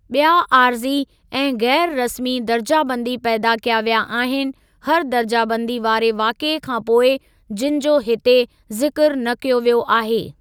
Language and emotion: Sindhi, neutral